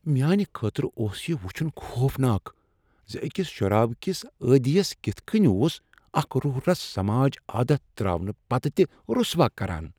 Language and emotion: Kashmiri, disgusted